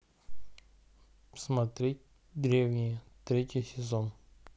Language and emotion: Russian, neutral